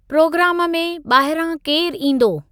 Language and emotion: Sindhi, neutral